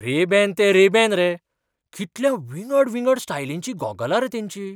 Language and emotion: Goan Konkani, surprised